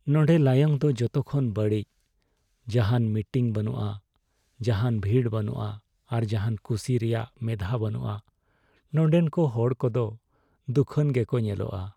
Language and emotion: Santali, sad